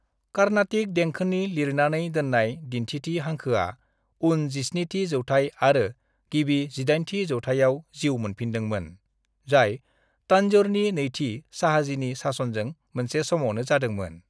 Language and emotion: Bodo, neutral